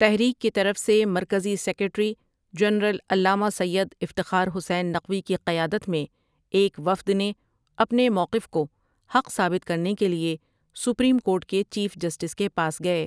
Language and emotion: Urdu, neutral